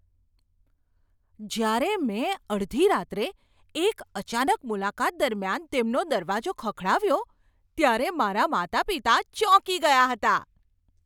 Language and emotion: Gujarati, surprised